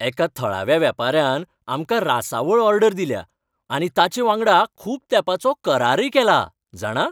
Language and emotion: Goan Konkani, happy